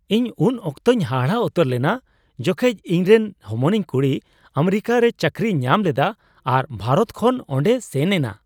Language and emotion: Santali, surprised